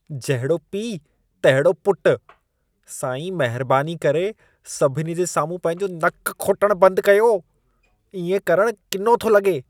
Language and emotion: Sindhi, disgusted